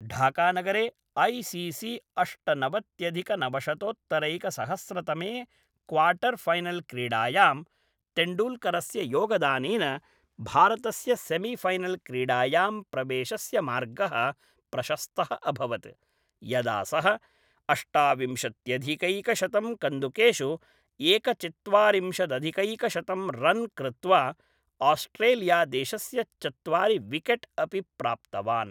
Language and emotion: Sanskrit, neutral